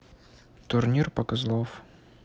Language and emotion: Russian, neutral